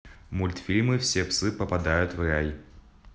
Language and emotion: Russian, neutral